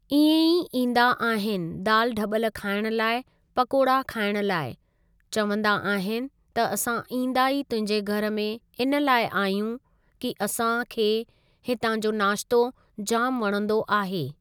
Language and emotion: Sindhi, neutral